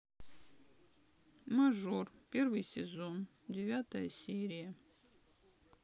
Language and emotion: Russian, sad